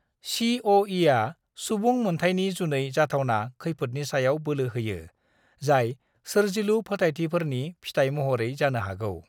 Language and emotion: Bodo, neutral